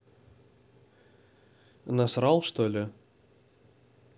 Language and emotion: Russian, neutral